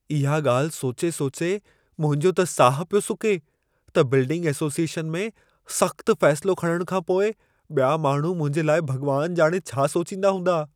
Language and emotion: Sindhi, fearful